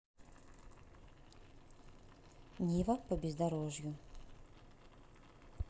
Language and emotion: Russian, neutral